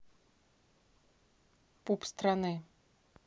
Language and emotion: Russian, neutral